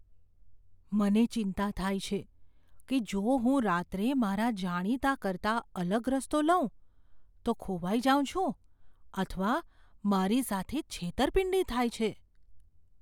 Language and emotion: Gujarati, fearful